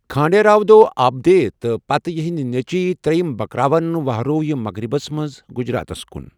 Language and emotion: Kashmiri, neutral